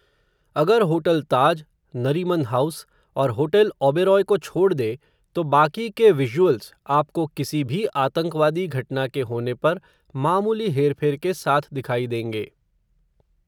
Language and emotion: Hindi, neutral